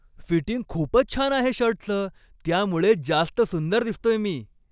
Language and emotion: Marathi, happy